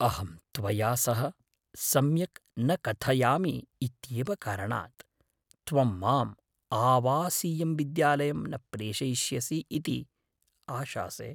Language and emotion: Sanskrit, fearful